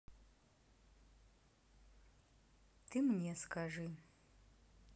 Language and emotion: Russian, neutral